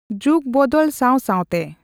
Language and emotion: Santali, neutral